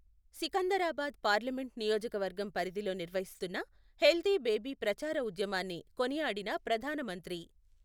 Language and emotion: Telugu, neutral